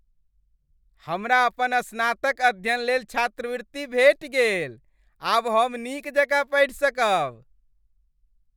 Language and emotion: Maithili, happy